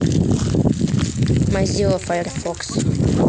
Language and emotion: Russian, neutral